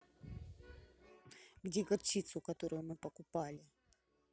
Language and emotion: Russian, angry